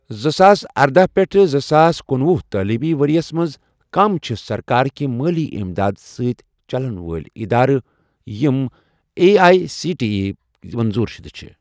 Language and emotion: Kashmiri, neutral